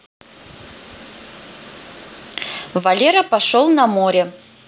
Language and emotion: Russian, neutral